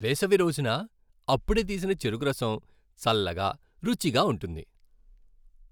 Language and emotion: Telugu, happy